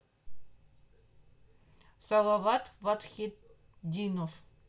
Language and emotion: Russian, neutral